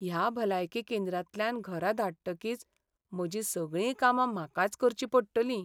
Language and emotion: Goan Konkani, sad